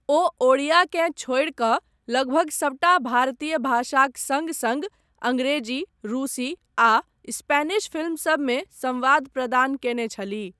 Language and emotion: Maithili, neutral